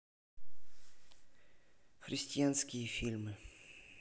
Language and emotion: Russian, neutral